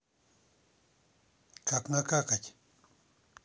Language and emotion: Russian, neutral